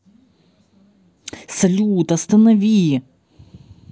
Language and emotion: Russian, angry